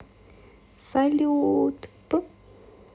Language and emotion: Russian, positive